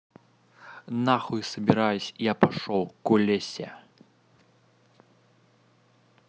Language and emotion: Russian, angry